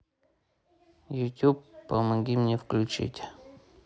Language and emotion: Russian, neutral